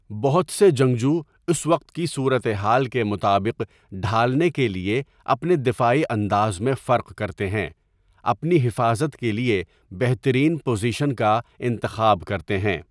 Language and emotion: Urdu, neutral